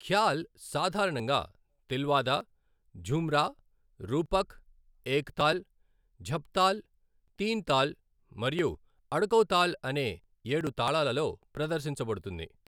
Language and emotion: Telugu, neutral